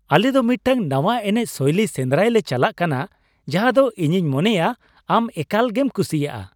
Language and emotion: Santali, happy